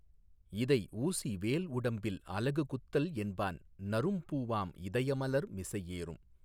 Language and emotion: Tamil, neutral